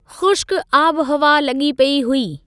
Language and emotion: Sindhi, neutral